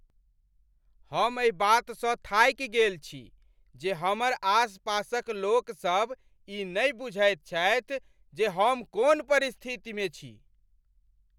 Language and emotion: Maithili, angry